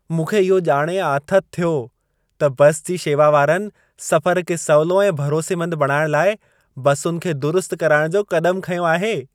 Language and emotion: Sindhi, happy